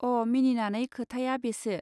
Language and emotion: Bodo, neutral